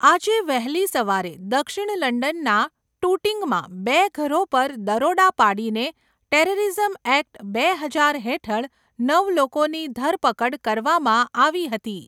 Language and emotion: Gujarati, neutral